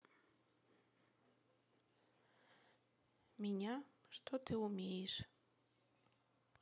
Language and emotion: Russian, neutral